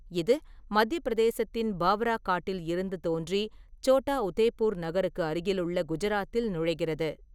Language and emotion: Tamil, neutral